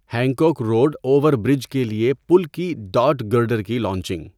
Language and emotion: Urdu, neutral